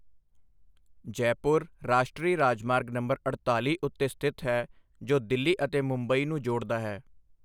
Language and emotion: Punjabi, neutral